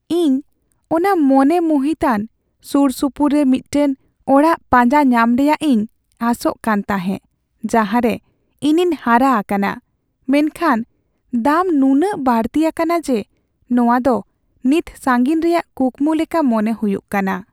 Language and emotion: Santali, sad